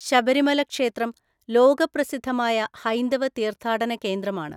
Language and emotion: Malayalam, neutral